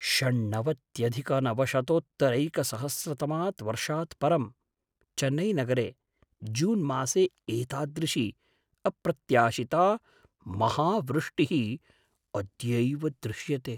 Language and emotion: Sanskrit, surprised